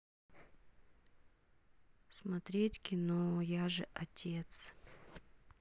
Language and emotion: Russian, sad